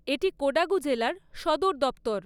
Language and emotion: Bengali, neutral